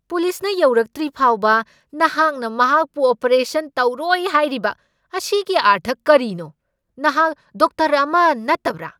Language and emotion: Manipuri, angry